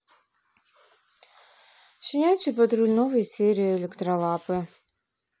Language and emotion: Russian, neutral